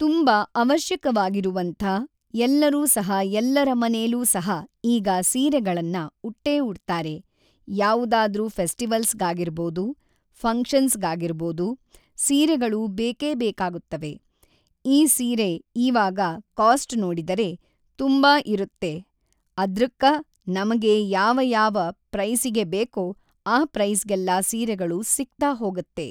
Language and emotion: Kannada, neutral